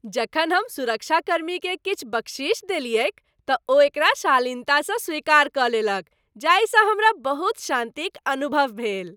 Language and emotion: Maithili, happy